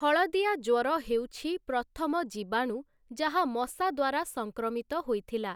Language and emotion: Odia, neutral